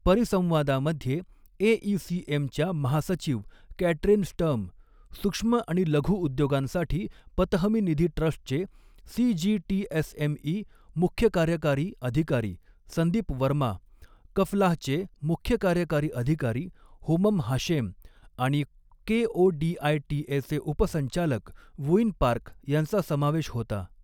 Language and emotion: Marathi, neutral